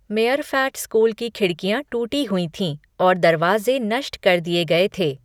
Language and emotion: Hindi, neutral